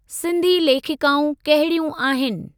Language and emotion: Sindhi, neutral